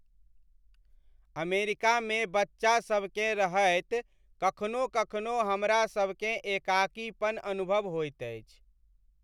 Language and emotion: Maithili, sad